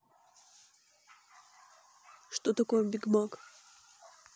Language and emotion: Russian, neutral